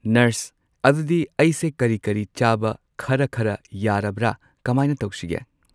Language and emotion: Manipuri, neutral